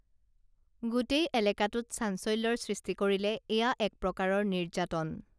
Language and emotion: Assamese, neutral